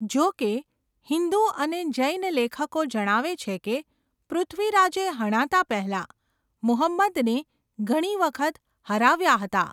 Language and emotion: Gujarati, neutral